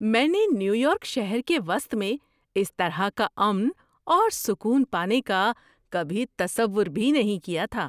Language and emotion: Urdu, surprised